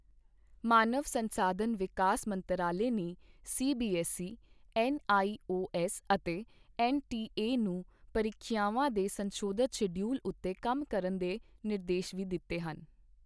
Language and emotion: Punjabi, neutral